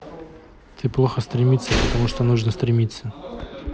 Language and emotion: Russian, neutral